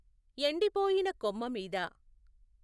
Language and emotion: Telugu, neutral